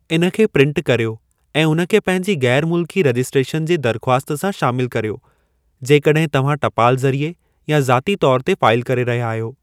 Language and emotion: Sindhi, neutral